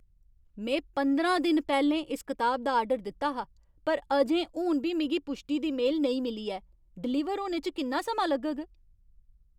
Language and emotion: Dogri, angry